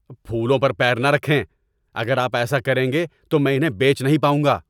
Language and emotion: Urdu, angry